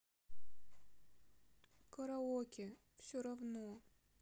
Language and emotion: Russian, sad